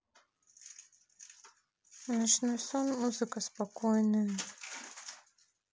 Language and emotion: Russian, neutral